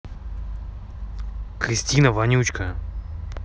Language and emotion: Russian, angry